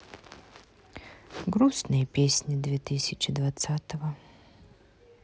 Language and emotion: Russian, sad